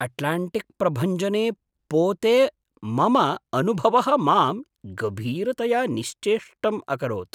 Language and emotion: Sanskrit, surprised